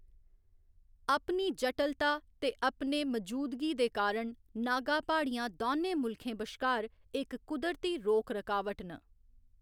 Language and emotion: Dogri, neutral